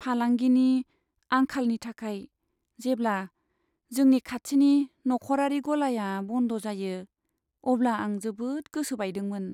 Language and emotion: Bodo, sad